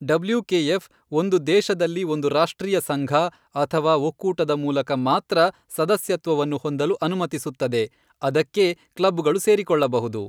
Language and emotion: Kannada, neutral